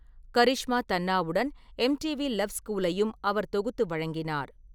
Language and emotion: Tamil, neutral